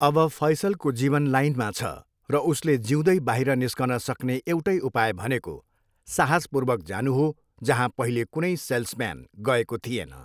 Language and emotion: Nepali, neutral